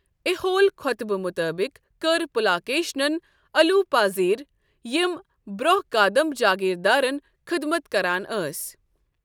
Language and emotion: Kashmiri, neutral